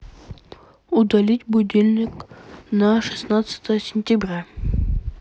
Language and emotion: Russian, neutral